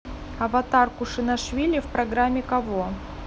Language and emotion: Russian, neutral